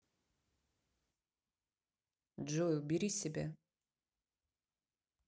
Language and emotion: Russian, neutral